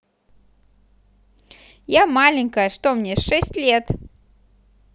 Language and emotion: Russian, positive